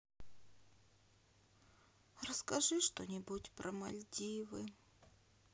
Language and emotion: Russian, sad